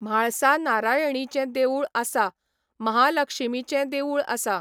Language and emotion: Goan Konkani, neutral